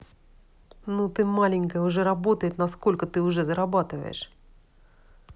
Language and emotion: Russian, angry